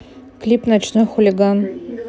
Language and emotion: Russian, neutral